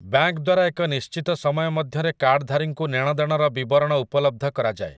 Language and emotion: Odia, neutral